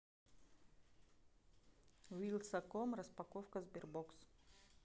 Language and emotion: Russian, neutral